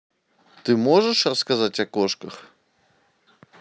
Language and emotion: Russian, neutral